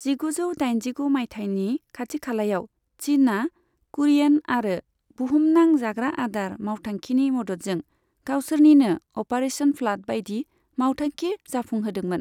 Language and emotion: Bodo, neutral